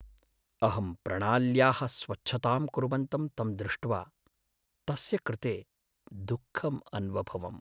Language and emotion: Sanskrit, sad